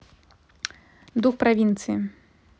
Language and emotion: Russian, neutral